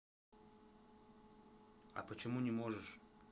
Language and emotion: Russian, neutral